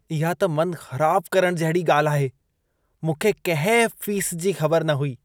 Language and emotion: Sindhi, disgusted